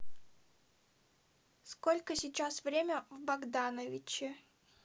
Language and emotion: Russian, neutral